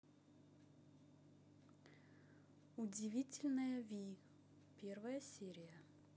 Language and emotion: Russian, neutral